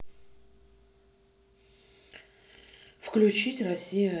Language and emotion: Russian, sad